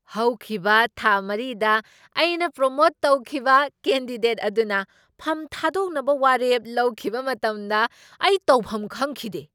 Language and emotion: Manipuri, surprised